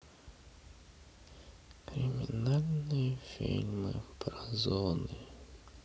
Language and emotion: Russian, sad